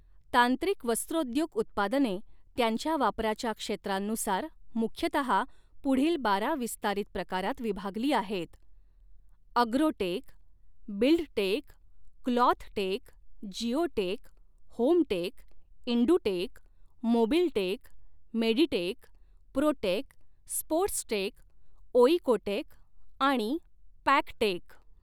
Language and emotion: Marathi, neutral